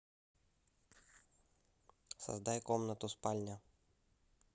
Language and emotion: Russian, neutral